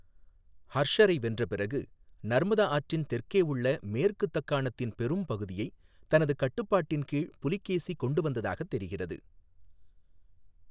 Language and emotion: Tamil, neutral